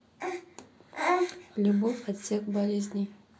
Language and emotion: Russian, neutral